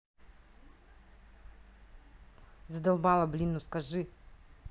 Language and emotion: Russian, angry